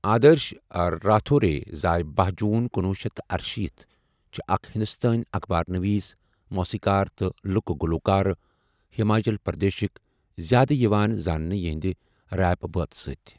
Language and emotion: Kashmiri, neutral